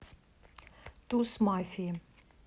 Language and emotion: Russian, neutral